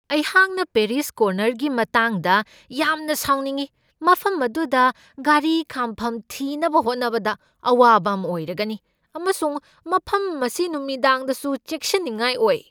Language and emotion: Manipuri, angry